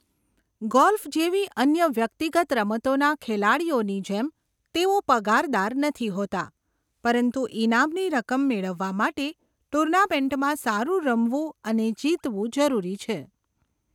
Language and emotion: Gujarati, neutral